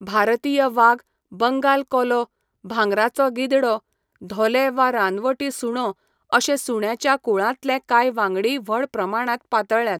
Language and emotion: Goan Konkani, neutral